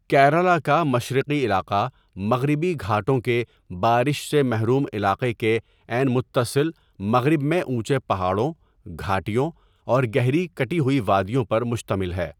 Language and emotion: Urdu, neutral